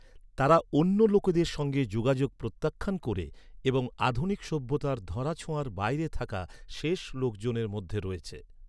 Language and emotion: Bengali, neutral